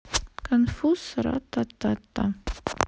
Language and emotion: Russian, neutral